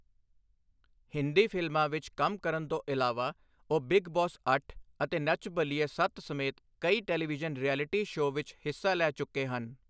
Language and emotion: Punjabi, neutral